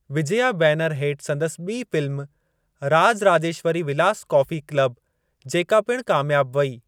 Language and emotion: Sindhi, neutral